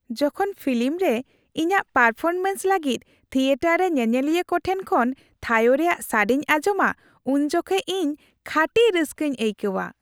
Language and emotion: Santali, happy